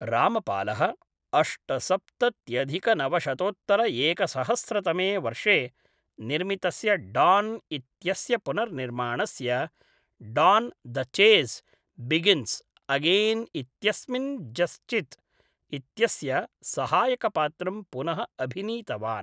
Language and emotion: Sanskrit, neutral